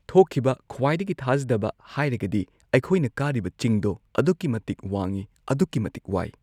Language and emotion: Manipuri, neutral